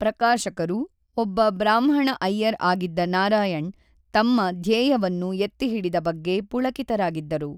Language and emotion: Kannada, neutral